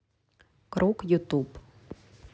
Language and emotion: Russian, neutral